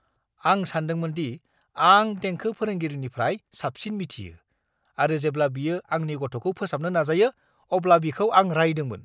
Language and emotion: Bodo, angry